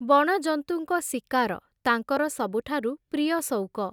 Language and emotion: Odia, neutral